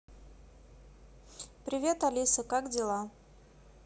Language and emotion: Russian, neutral